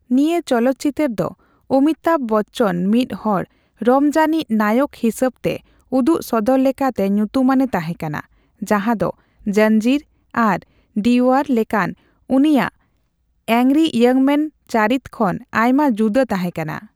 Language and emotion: Santali, neutral